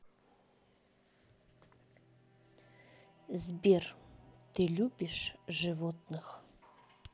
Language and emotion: Russian, neutral